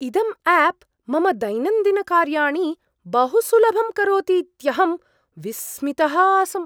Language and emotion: Sanskrit, surprised